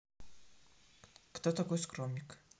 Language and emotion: Russian, neutral